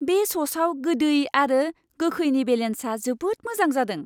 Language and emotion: Bodo, happy